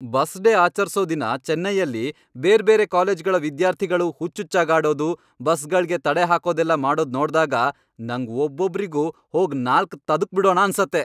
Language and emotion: Kannada, angry